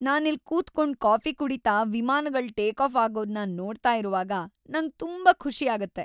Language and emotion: Kannada, happy